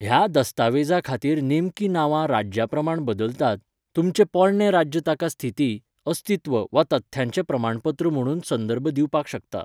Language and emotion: Goan Konkani, neutral